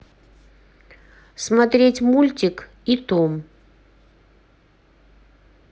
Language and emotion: Russian, neutral